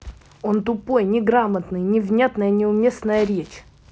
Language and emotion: Russian, angry